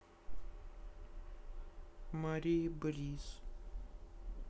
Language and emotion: Russian, neutral